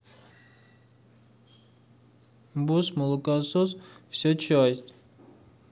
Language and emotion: Russian, sad